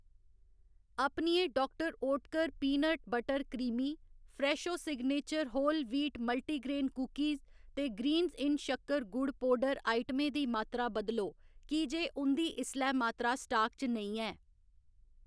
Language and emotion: Dogri, neutral